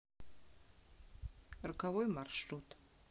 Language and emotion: Russian, neutral